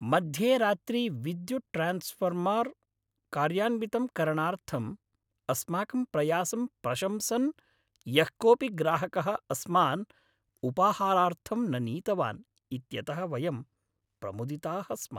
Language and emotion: Sanskrit, happy